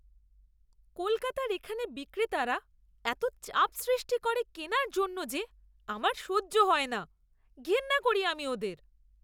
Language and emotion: Bengali, disgusted